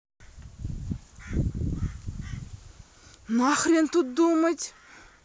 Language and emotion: Russian, angry